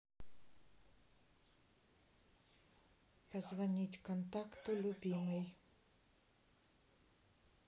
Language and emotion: Russian, neutral